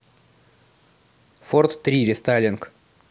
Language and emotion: Russian, neutral